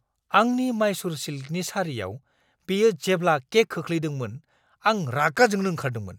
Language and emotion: Bodo, angry